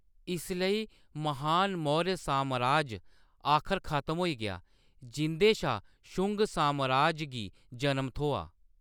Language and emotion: Dogri, neutral